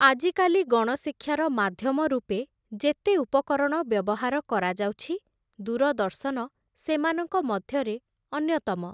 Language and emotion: Odia, neutral